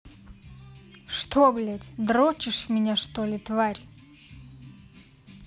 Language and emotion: Russian, angry